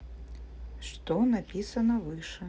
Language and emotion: Russian, neutral